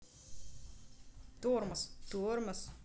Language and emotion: Russian, neutral